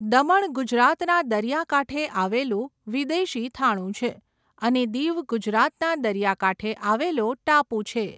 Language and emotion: Gujarati, neutral